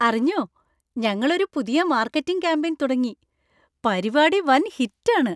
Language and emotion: Malayalam, happy